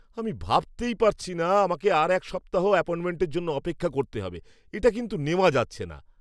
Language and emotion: Bengali, angry